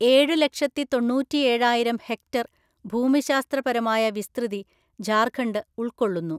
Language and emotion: Malayalam, neutral